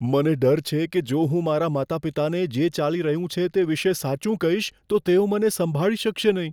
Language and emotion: Gujarati, fearful